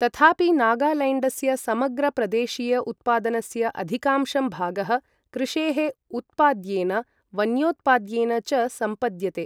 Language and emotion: Sanskrit, neutral